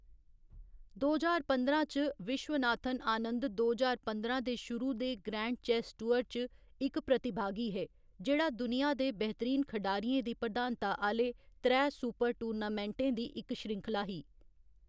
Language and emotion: Dogri, neutral